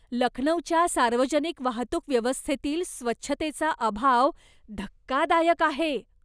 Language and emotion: Marathi, disgusted